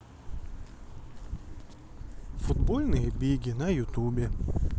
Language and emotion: Russian, sad